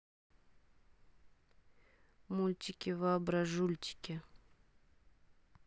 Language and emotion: Russian, neutral